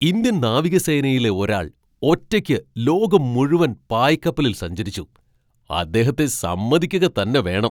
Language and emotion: Malayalam, surprised